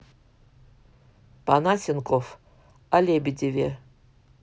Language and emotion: Russian, neutral